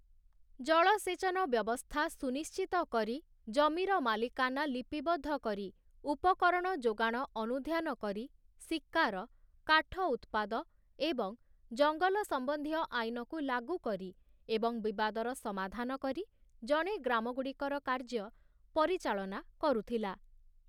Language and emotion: Odia, neutral